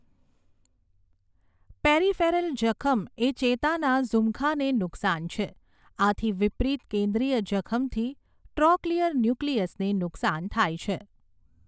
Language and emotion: Gujarati, neutral